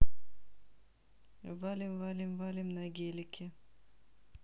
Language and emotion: Russian, neutral